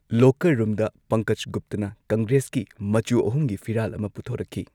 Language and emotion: Manipuri, neutral